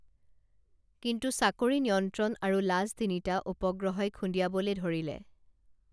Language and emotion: Assamese, neutral